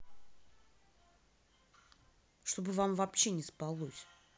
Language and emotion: Russian, angry